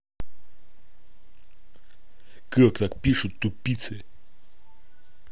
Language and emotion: Russian, angry